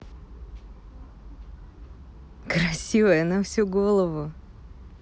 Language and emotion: Russian, positive